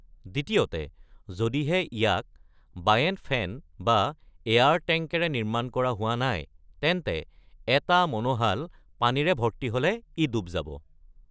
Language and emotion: Assamese, neutral